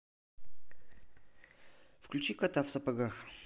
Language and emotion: Russian, neutral